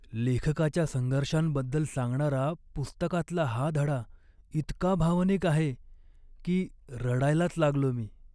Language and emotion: Marathi, sad